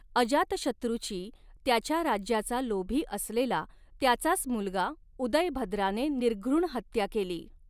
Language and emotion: Marathi, neutral